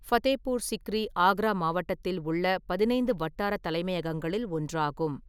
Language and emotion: Tamil, neutral